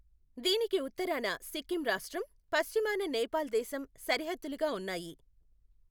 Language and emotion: Telugu, neutral